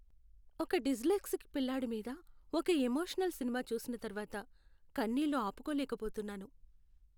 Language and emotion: Telugu, sad